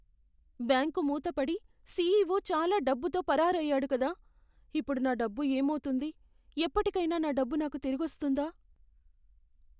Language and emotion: Telugu, fearful